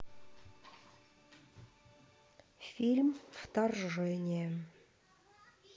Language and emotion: Russian, neutral